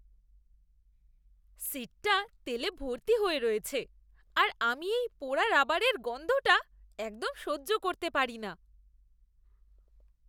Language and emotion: Bengali, disgusted